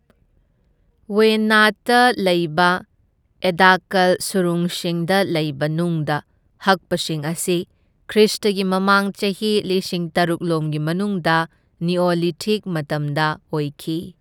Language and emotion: Manipuri, neutral